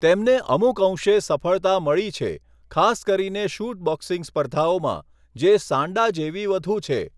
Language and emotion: Gujarati, neutral